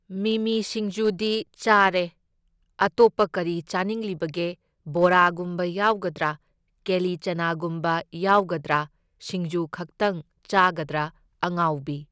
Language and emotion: Manipuri, neutral